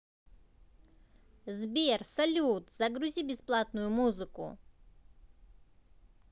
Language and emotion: Russian, positive